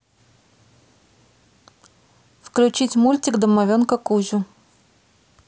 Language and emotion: Russian, neutral